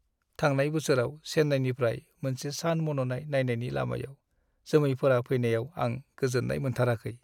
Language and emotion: Bodo, sad